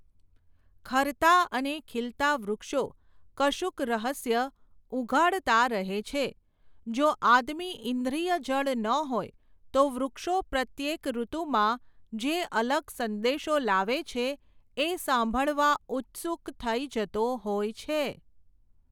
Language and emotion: Gujarati, neutral